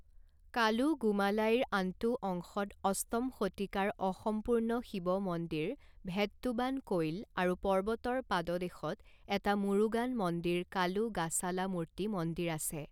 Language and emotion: Assamese, neutral